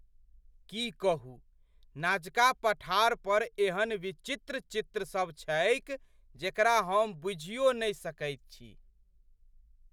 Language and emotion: Maithili, surprised